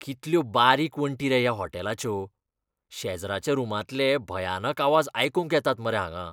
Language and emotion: Goan Konkani, disgusted